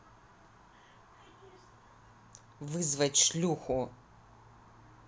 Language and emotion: Russian, angry